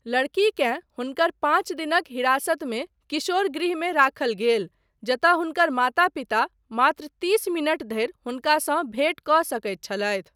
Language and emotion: Maithili, neutral